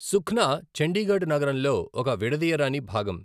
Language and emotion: Telugu, neutral